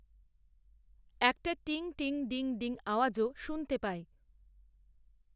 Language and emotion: Bengali, neutral